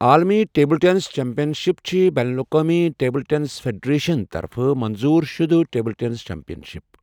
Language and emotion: Kashmiri, neutral